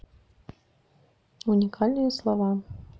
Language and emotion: Russian, neutral